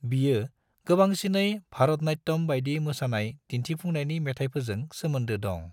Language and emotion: Bodo, neutral